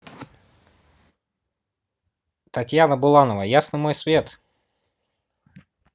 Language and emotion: Russian, positive